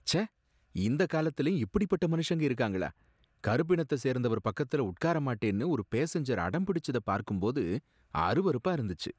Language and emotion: Tamil, disgusted